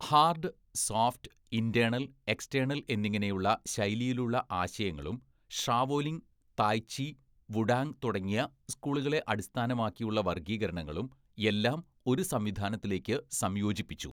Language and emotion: Malayalam, neutral